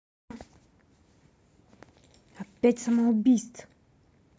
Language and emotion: Russian, angry